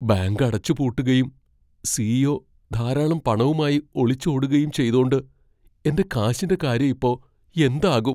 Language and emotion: Malayalam, fearful